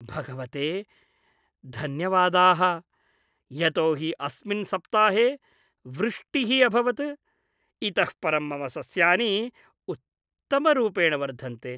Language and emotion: Sanskrit, happy